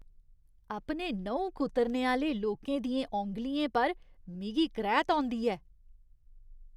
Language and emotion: Dogri, disgusted